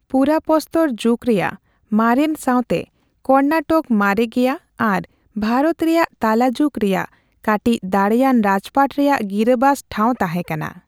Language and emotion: Santali, neutral